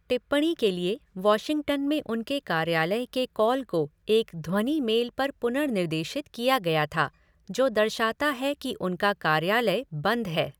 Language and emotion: Hindi, neutral